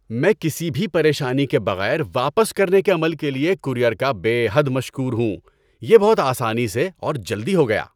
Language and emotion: Urdu, happy